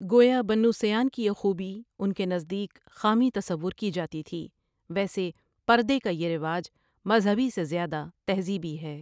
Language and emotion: Urdu, neutral